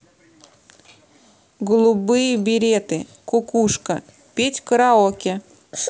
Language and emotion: Russian, neutral